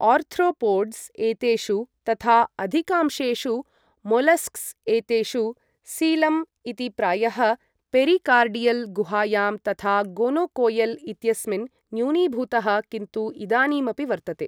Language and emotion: Sanskrit, neutral